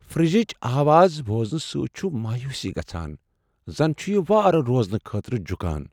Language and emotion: Kashmiri, sad